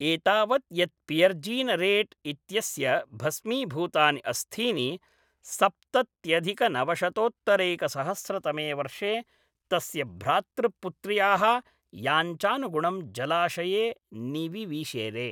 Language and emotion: Sanskrit, neutral